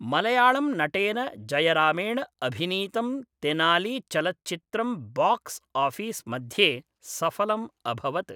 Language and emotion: Sanskrit, neutral